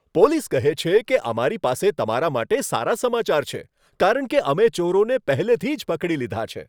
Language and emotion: Gujarati, happy